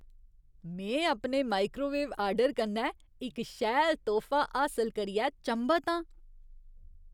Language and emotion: Dogri, surprised